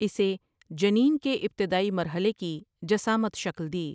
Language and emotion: Urdu, neutral